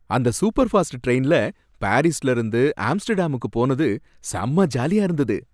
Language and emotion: Tamil, happy